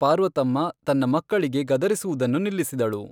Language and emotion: Kannada, neutral